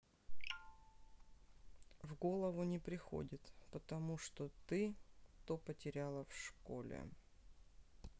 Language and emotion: Russian, neutral